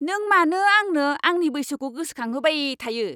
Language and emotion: Bodo, angry